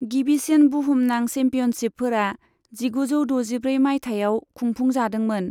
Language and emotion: Bodo, neutral